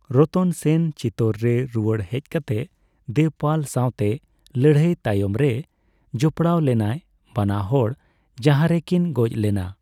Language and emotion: Santali, neutral